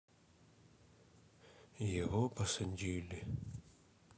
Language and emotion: Russian, sad